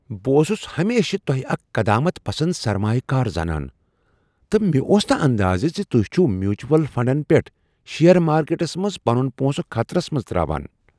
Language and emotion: Kashmiri, surprised